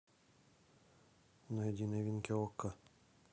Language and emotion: Russian, neutral